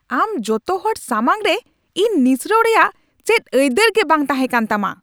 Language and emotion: Santali, angry